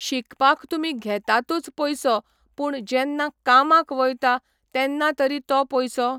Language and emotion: Goan Konkani, neutral